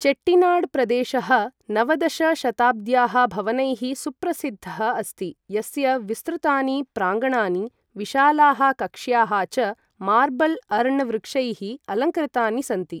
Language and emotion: Sanskrit, neutral